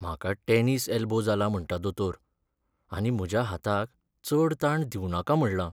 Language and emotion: Goan Konkani, sad